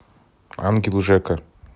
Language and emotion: Russian, neutral